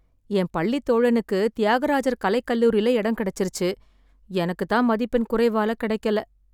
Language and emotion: Tamil, sad